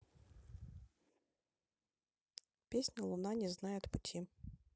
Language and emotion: Russian, neutral